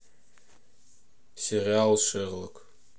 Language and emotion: Russian, neutral